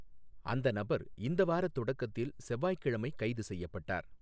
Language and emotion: Tamil, neutral